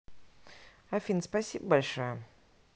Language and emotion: Russian, neutral